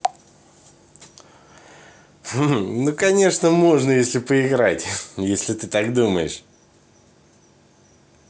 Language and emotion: Russian, positive